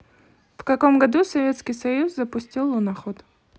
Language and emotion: Russian, neutral